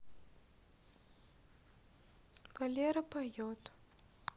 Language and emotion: Russian, neutral